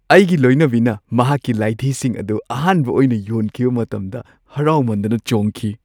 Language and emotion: Manipuri, happy